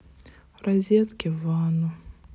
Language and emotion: Russian, sad